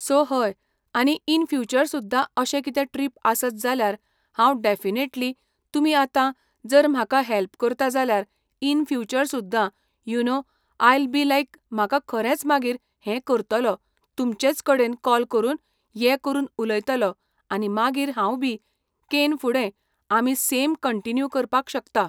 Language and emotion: Goan Konkani, neutral